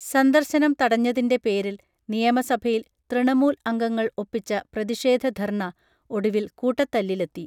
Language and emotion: Malayalam, neutral